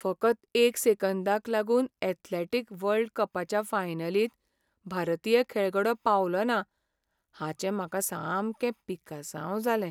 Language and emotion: Goan Konkani, sad